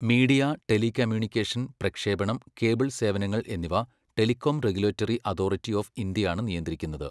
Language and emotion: Malayalam, neutral